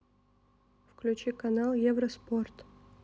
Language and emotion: Russian, neutral